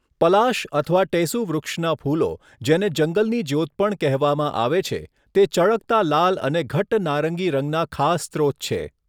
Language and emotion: Gujarati, neutral